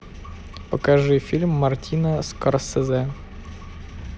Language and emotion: Russian, neutral